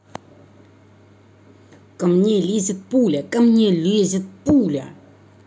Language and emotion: Russian, angry